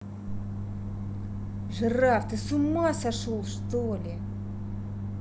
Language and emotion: Russian, angry